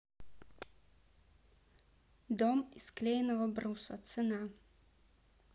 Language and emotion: Russian, neutral